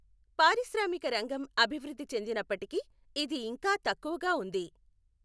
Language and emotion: Telugu, neutral